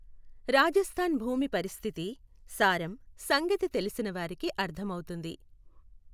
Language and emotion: Telugu, neutral